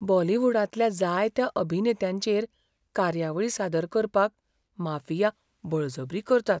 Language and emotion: Goan Konkani, fearful